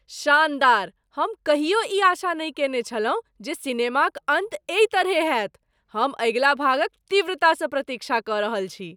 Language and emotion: Maithili, surprised